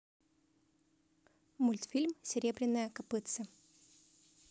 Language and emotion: Russian, neutral